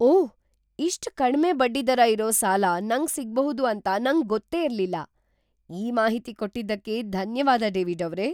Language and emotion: Kannada, surprised